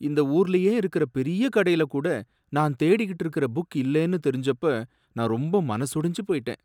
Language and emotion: Tamil, sad